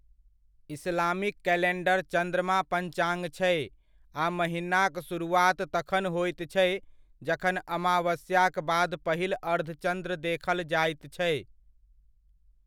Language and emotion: Maithili, neutral